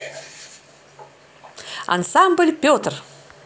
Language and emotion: Russian, positive